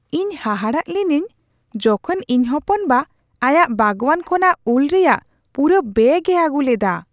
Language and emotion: Santali, surprised